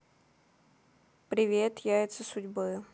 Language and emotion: Russian, neutral